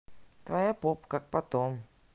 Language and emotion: Russian, neutral